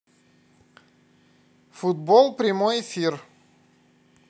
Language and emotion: Russian, positive